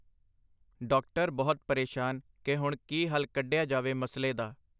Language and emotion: Punjabi, neutral